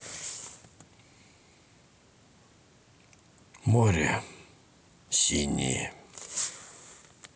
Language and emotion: Russian, sad